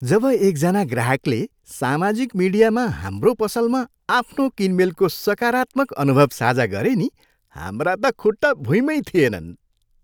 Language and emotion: Nepali, happy